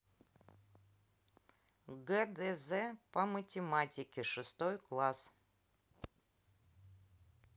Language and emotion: Russian, neutral